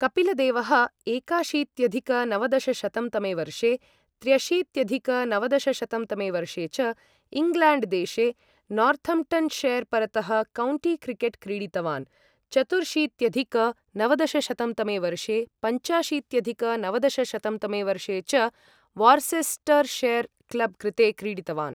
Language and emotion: Sanskrit, neutral